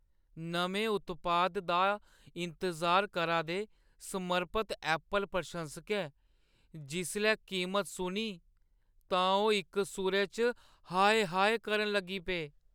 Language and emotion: Dogri, sad